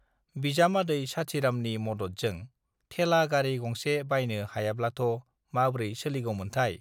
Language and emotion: Bodo, neutral